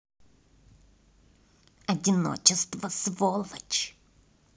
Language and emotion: Russian, angry